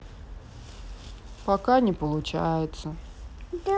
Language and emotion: Russian, sad